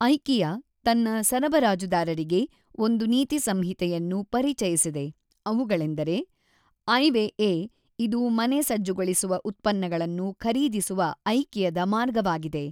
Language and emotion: Kannada, neutral